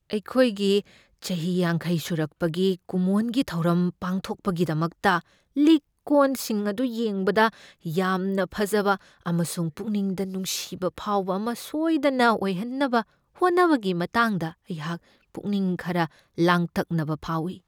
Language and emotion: Manipuri, fearful